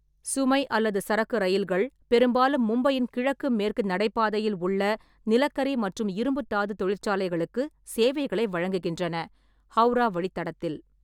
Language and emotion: Tamil, neutral